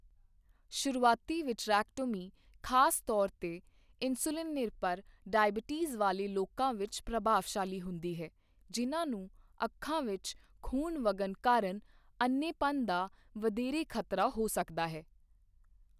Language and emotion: Punjabi, neutral